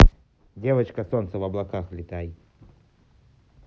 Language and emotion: Russian, neutral